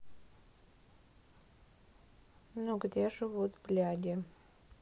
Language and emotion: Russian, sad